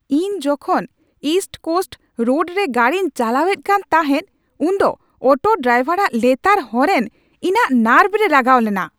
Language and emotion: Santali, angry